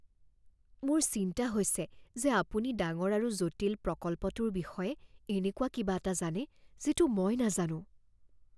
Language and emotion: Assamese, fearful